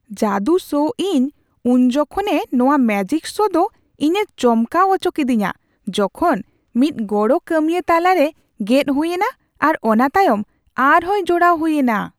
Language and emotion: Santali, surprised